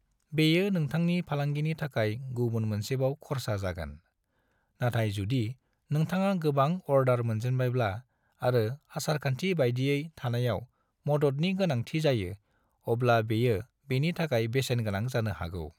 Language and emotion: Bodo, neutral